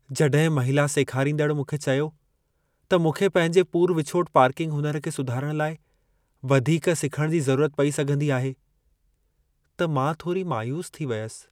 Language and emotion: Sindhi, sad